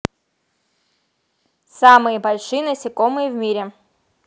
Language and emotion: Russian, neutral